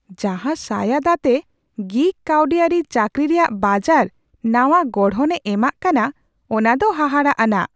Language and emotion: Santali, surprised